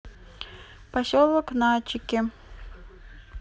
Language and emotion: Russian, neutral